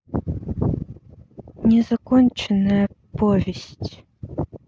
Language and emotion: Russian, neutral